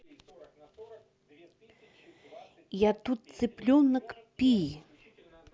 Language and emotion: Russian, neutral